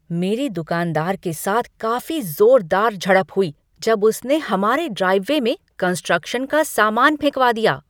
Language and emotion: Hindi, angry